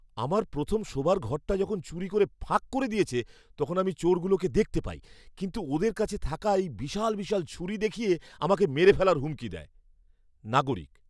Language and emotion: Bengali, fearful